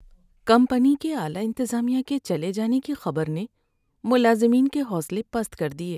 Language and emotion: Urdu, sad